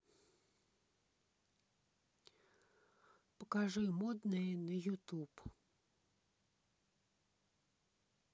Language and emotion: Russian, neutral